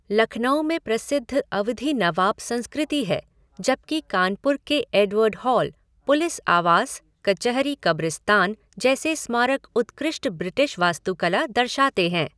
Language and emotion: Hindi, neutral